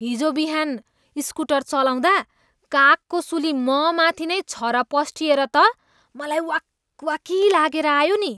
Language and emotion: Nepali, disgusted